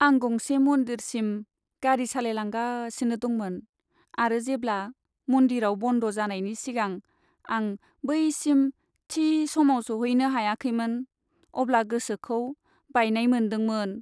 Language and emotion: Bodo, sad